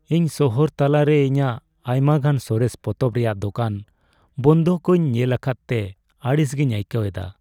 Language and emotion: Santali, sad